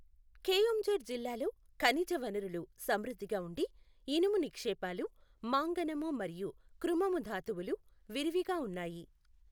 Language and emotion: Telugu, neutral